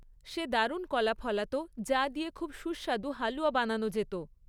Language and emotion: Bengali, neutral